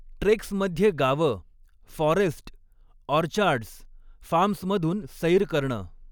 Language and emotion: Marathi, neutral